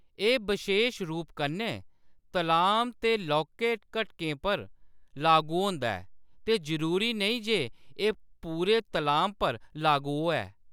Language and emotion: Dogri, neutral